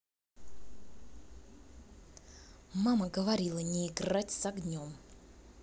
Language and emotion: Russian, angry